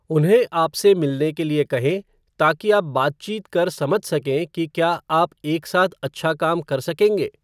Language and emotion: Hindi, neutral